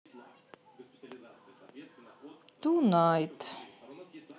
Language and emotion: Russian, neutral